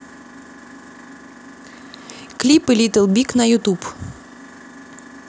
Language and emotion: Russian, neutral